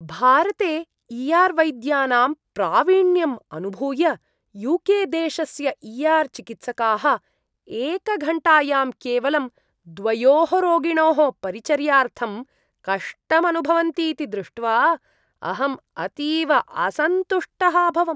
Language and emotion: Sanskrit, disgusted